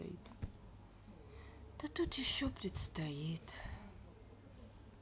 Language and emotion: Russian, sad